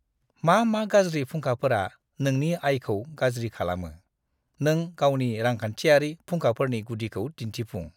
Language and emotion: Bodo, disgusted